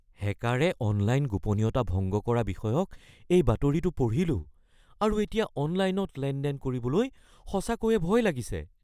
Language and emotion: Assamese, fearful